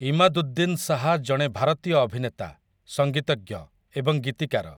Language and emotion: Odia, neutral